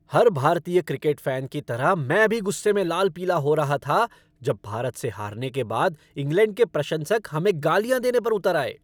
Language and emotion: Hindi, angry